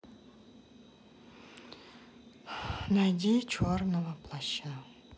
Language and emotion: Russian, sad